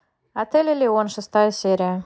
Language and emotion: Russian, neutral